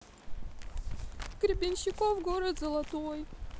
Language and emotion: Russian, sad